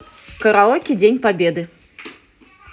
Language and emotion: Russian, positive